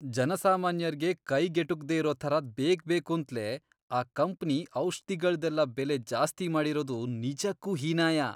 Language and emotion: Kannada, disgusted